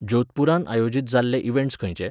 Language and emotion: Goan Konkani, neutral